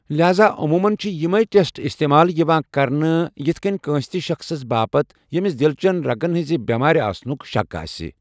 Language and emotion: Kashmiri, neutral